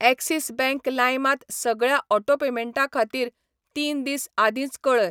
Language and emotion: Goan Konkani, neutral